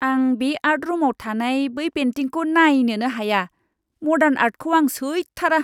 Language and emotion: Bodo, disgusted